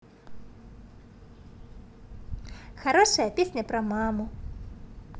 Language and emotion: Russian, positive